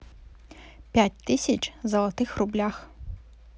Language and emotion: Russian, neutral